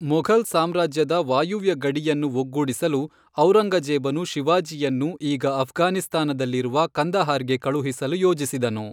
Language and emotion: Kannada, neutral